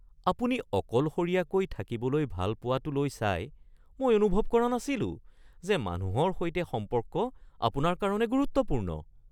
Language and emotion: Assamese, surprised